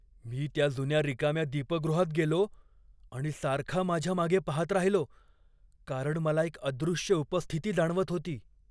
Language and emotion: Marathi, fearful